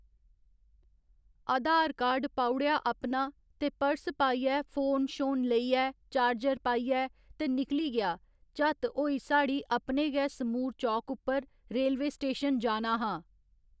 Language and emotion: Dogri, neutral